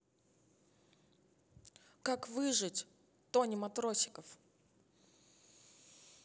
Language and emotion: Russian, neutral